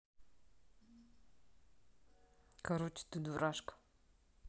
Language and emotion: Russian, neutral